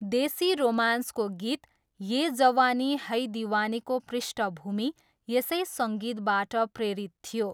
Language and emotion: Nepali, neutral